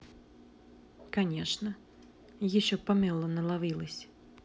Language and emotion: Russian, neutral